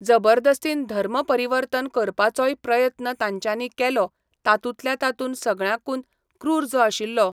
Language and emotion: Goan Konkani, neutral